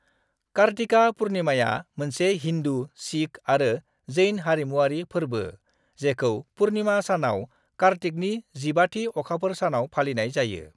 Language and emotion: Bodo, neutral